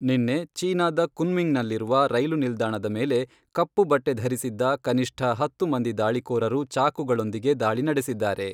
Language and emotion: Kannada, neutral